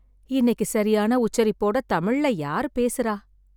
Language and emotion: Tamil, sad